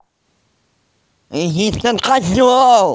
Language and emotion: Russian, angry